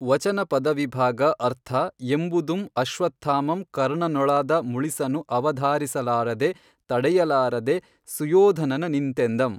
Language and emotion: Kannada, neutral